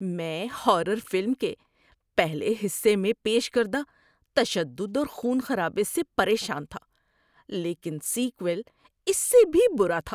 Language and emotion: Urdu, disgusted